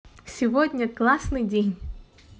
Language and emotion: Russian, positive